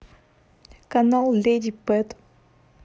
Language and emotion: Russian, neutral